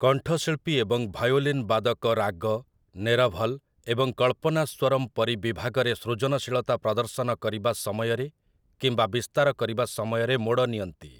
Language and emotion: Odia, neutral